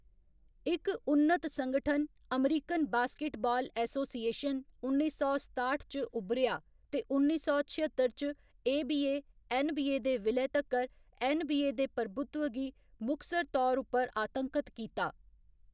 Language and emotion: Dogri, neutral